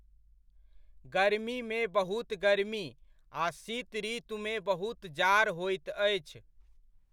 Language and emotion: Maithili, neutral